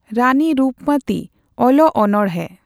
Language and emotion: Santali, neutral